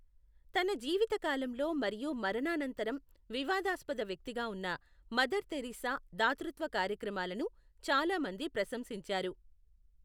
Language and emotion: Telugu, neutral